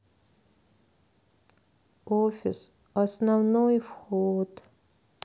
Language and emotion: Russian, sad